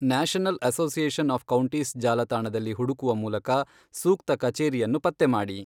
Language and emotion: Kannada, neutral